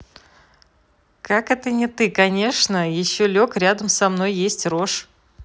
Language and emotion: Russian, positive